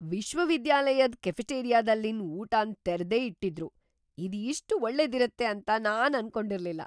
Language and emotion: Kannada, surprised